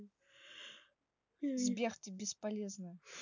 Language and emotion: Russian, neutral